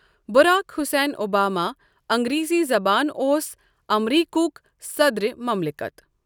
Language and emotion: Kashmiri, neutral